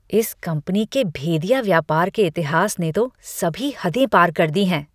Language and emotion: Hindi, disgusted